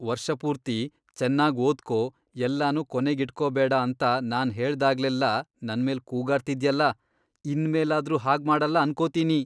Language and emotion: Kannada, disgusted